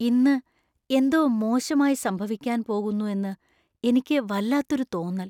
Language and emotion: Malayalam, fearful